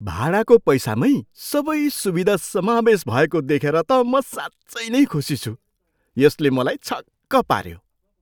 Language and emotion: Nepali, surprised